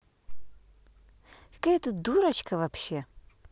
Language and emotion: Russian, angry